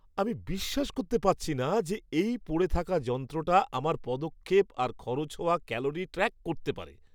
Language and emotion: Bengali, surprised